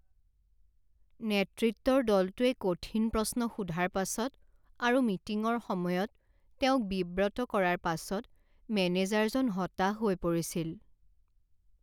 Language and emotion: Assamese, sad